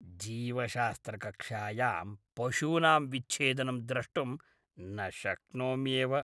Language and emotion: Sanskrit, disgusted